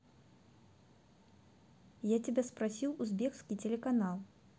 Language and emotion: Russian, neutral